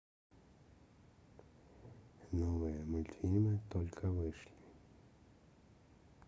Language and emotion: Russian, neutral